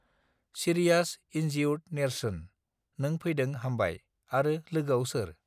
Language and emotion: Bodo, neutral